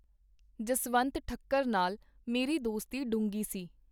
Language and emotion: Punjabi, neutral